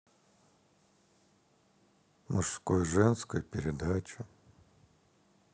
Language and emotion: Russian, sad